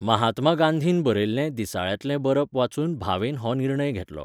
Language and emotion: Goan Konkani, neutral